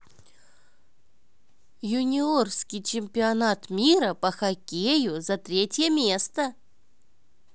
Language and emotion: Russian, positive